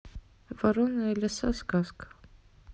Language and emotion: Russian, neutral